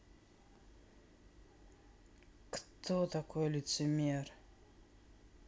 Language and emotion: Russian, sad